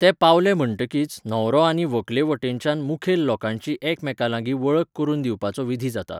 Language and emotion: Goan Konkani, neutral